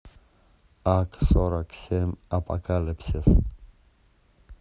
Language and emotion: Russian, neutral